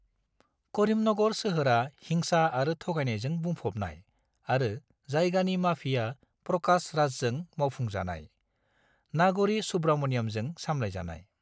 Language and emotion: Bodo, neutral